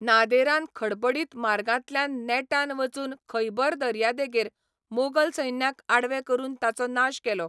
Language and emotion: Goan Konkani, neutral